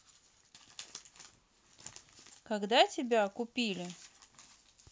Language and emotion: Russian, neutral